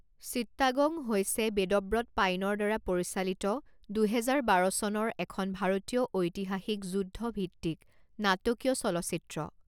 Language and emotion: Assamese, neutral